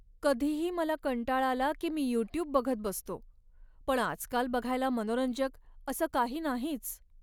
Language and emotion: Marathi, sad